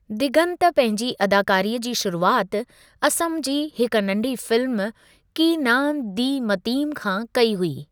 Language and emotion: Sindhi, neutral